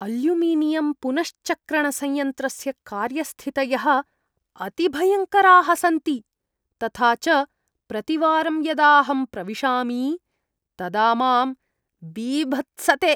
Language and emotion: Sanskrit, disgusted